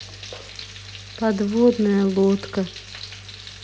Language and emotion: Russian, sad